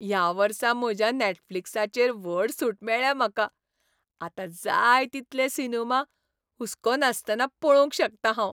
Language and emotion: Goan Konkani, happy